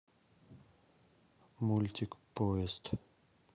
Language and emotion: Russian, neutral